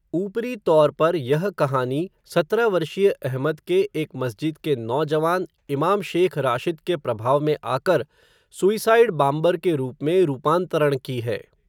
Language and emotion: Hindi, neutral